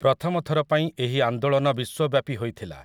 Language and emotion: Odia, neutral